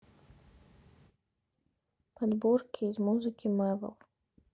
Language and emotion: Russian, neutral